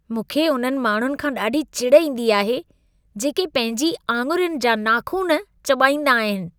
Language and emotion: Sindhi, disgusted